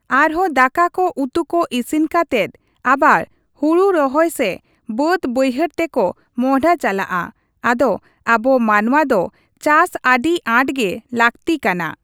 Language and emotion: Santali, neutral